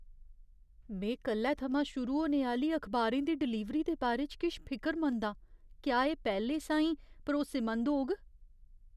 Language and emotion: Dogri, fearful